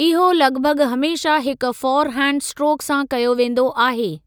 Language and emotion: Sindhi, neutral